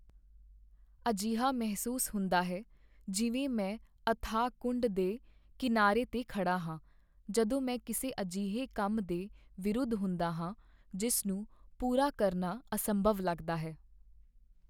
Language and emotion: Punjabi, sad